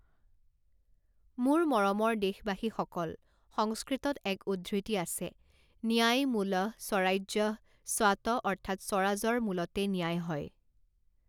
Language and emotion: Assamese, neutral